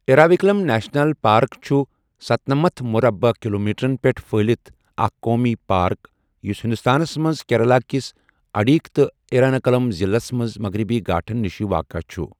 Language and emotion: Kashmiri, neutral